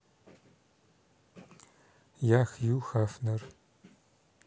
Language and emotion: Russian, neutral